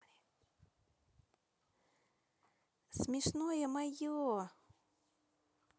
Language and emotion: Russian, positive